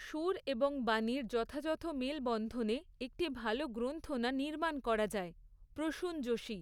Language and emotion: Bengali, neutral